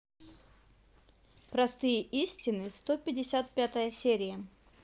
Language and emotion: Russian, neutral